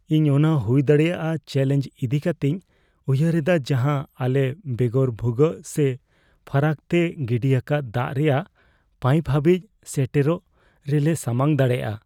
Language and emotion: Santali, fearful